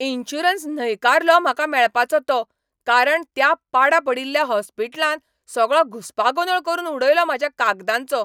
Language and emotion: Goan Konkani, angry